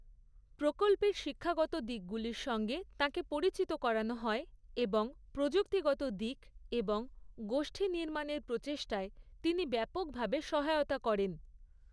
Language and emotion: Bengali, neutral